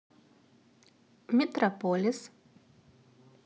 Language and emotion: Russian, neutral